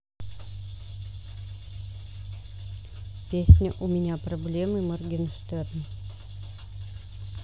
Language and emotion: Russian, neutral